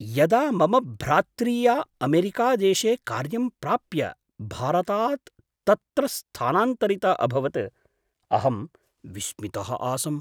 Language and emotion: Sanskrit, surprised